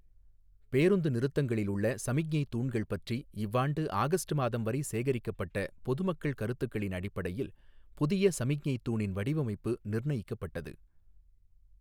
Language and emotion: Tamil, neutral